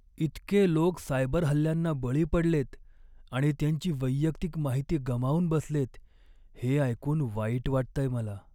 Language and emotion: Marathi, sad